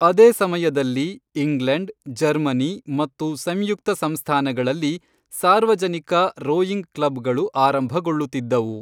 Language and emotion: Kannada, neutral